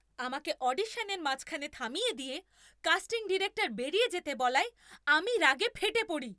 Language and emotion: Bengali, angry